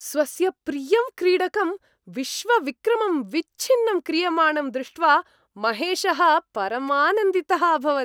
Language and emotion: Sanskrit, happy